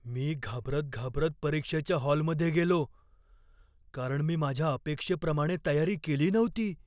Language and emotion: Marathi, fearful